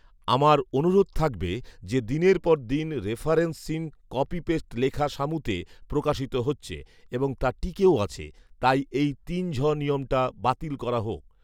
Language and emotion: Bengali, neutral